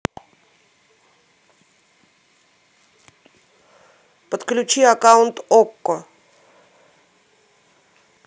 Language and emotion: Russian, neutral